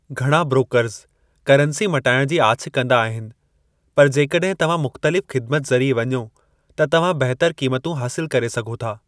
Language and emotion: Sindhi, neutral